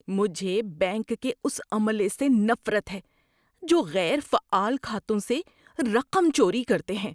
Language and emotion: Urdu, disgusted